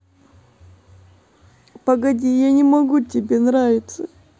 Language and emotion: Russian, sad